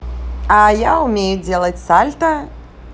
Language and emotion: Russian, positive